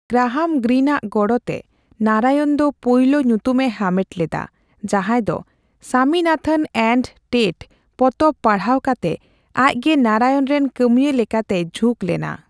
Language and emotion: Santali, neutral